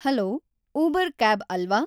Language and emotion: Kannada, neutral